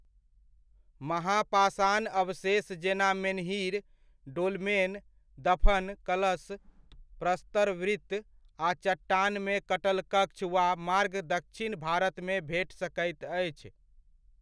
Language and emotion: Maithili, neutral